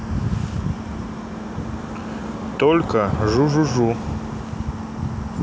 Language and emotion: Russian, neutral